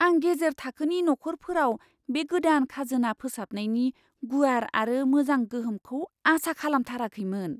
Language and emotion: Bodo, surprised